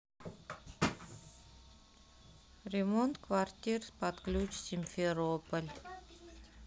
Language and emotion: Russian, sad